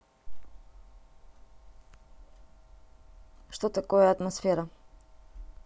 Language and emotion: Russian, neutral